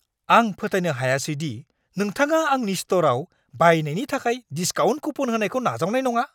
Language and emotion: Bodo, angry